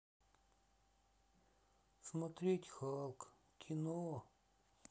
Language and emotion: Russian, sad